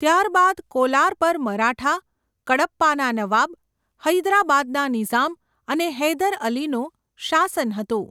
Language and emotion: Gujarati, neutral